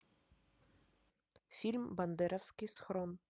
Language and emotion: Russian, neutral